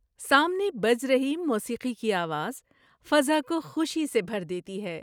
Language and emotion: Urdu, happy